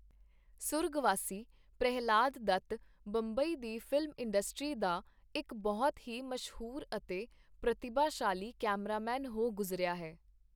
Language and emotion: Punjabi, neutral